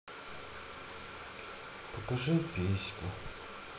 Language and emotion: Russian, sad